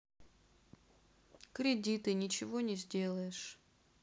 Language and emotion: Russian, sad